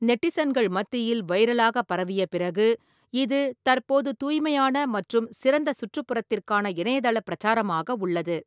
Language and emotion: Tamil, neutral